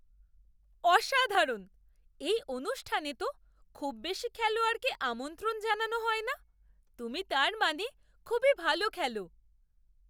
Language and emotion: Bengali, surprised